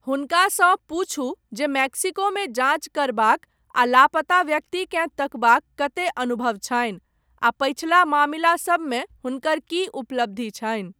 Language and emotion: Maithili, neutral